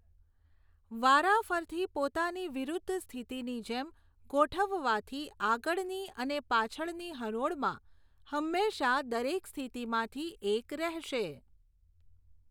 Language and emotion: Gujarati, neutral